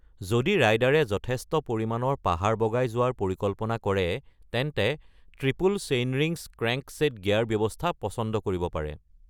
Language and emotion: Assamese, neutral